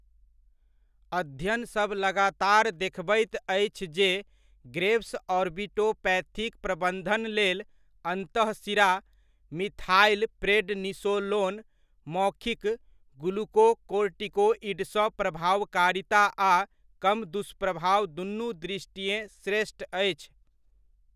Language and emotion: Maithili, neutral